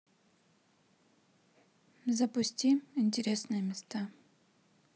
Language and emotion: Russian, neutral